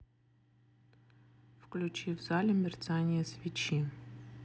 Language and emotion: Russian, neutral